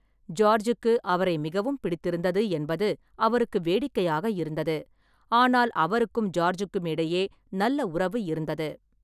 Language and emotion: Tamil, neutral